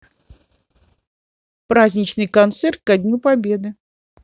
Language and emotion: Russian, positive